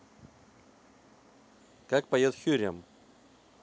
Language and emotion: Russian, neutral